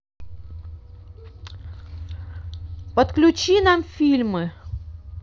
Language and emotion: Russian, neutral